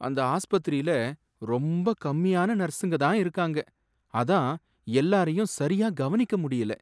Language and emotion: Tamil, sad